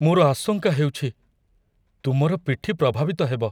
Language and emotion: Odia, fearful